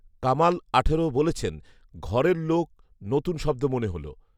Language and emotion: Bengali, neutral